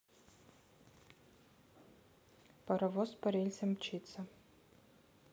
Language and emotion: Russian, neutral